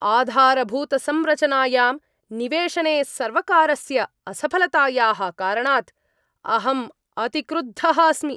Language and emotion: Sanskrit, angry